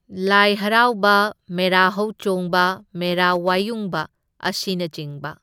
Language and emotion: Manipuri, neutral